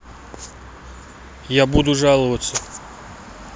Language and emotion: Russian, neutral